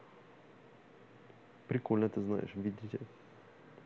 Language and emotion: Russian, neutral